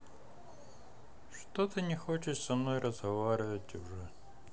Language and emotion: Russian, sad